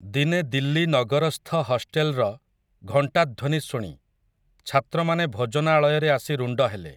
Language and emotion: Odia, neutral